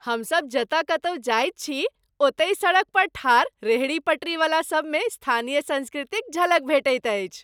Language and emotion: Maithili, happy